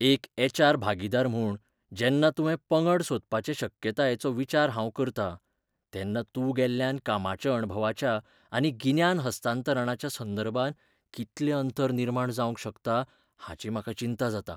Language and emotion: Goan Konkani, fearful